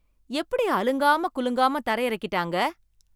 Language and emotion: Tamil, surprised